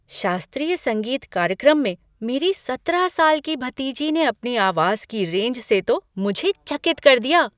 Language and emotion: Hindi, surprised